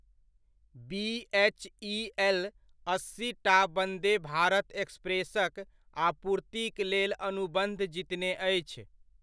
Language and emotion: Maithili, neutral